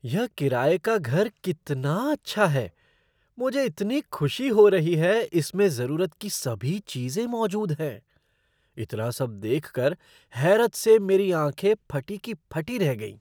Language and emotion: Hindi, surprised